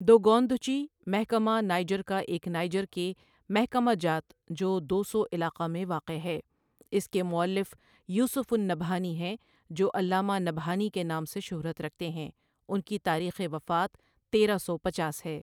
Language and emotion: Urdu, neutral